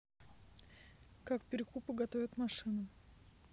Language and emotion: Russian, neutral